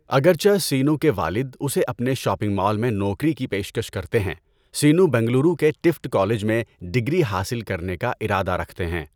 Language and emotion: Urdu, neutral